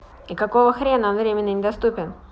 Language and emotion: Russian, angry